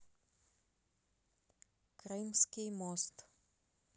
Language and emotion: Russian, neutral